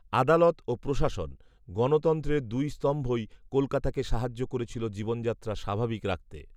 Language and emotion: Bengali, neutral